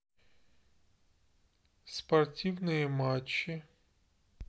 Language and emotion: Russian, neutral